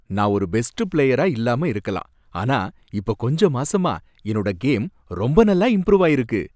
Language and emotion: Tamil, happy